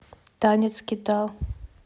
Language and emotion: Russian, neutral